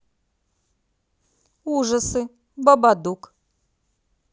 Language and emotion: Russian, positive